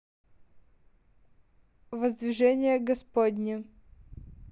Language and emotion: Russian, neutral